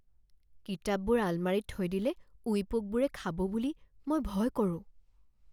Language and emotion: Assamese, fearful